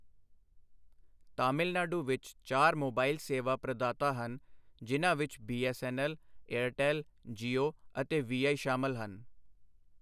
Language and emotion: Punjabi, neutral